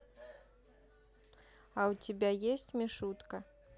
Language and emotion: Russian, neutral